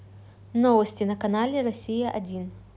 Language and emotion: Russian, neutral